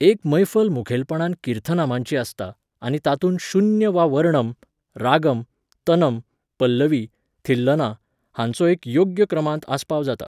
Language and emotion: Goan Konkani, neutral